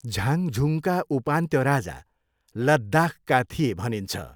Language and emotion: Nepali, neutral